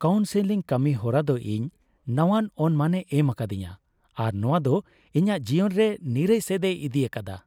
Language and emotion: Santali, happy